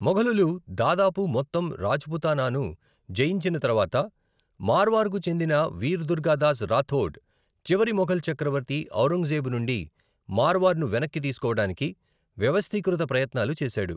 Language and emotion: Telugu, neutral